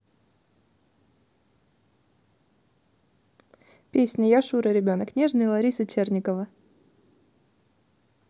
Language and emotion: Russian, neutral